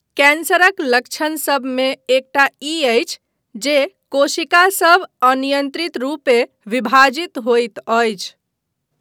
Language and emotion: Maithili, neutral